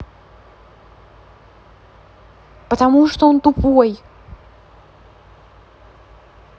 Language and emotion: Russian, angry